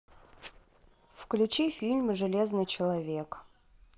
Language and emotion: Russian, neutral